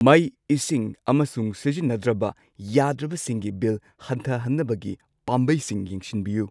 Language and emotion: Manipuri, neutral